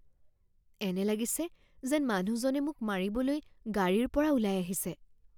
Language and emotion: Assamese, fearful